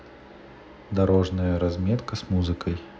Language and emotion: Russian, neutral